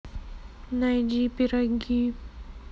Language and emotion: Russian, sad